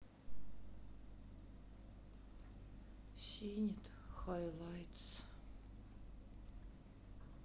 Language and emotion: Russian, sad